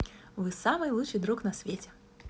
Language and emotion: Russian, positive